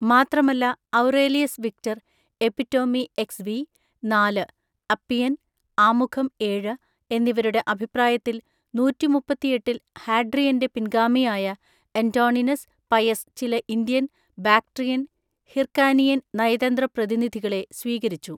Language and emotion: Malayalam, neutral